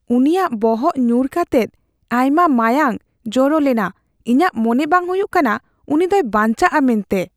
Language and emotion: Santali, fearful